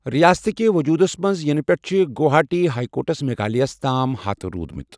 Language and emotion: Kashmiri, neutral